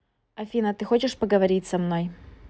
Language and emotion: Russian, neutral